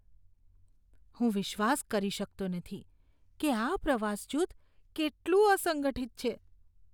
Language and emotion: Gujarati, disgusted